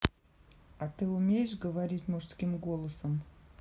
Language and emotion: Russian, neutral